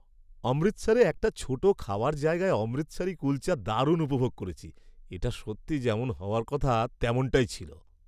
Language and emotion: Bengali, happy